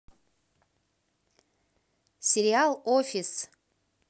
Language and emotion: Russian, positive